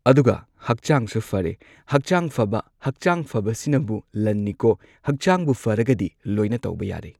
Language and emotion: Manipuri, neutral